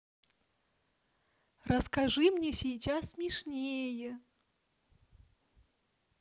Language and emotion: Russian, neutral